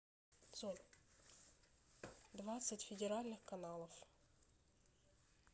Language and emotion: Russian, neutral